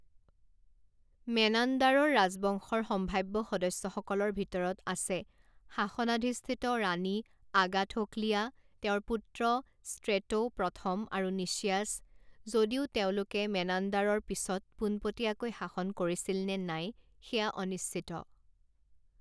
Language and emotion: Assamese, neutral